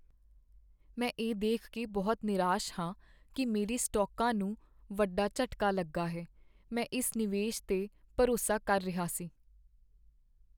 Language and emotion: Punjabi, sad